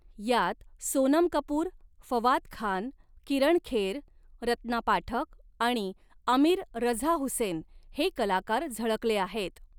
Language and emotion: Marathi, neutral